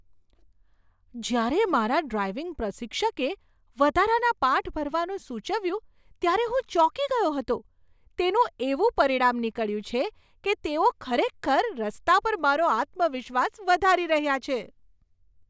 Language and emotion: Gujarati, surprised